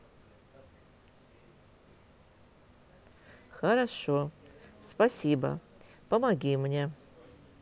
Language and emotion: Russian, neutral